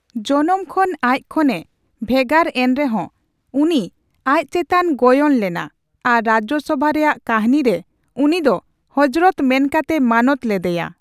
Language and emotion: Santali, neutral